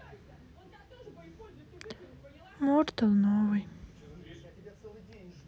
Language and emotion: Russian, sad